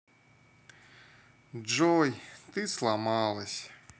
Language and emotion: Russian, sad